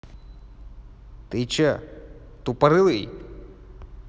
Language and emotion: Russian, angry